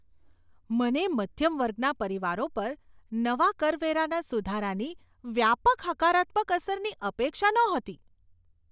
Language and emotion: Gujarati, surprised